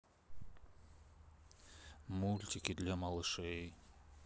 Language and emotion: Russian, sad